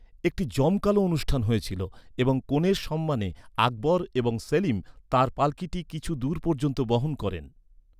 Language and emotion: Bengali, neutral